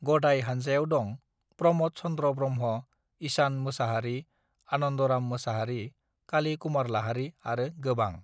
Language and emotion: Bodo, neutral